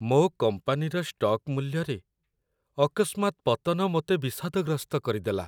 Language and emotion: Odia, sad